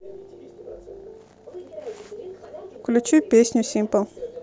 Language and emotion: Russian, neutral